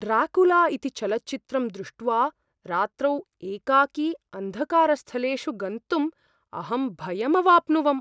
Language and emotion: Sanskrit, fearful